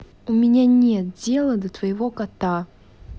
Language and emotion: Russian, angry